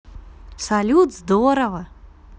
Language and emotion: Russian, positive